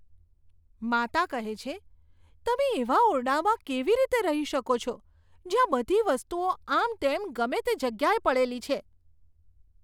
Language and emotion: Gujarati, disgusted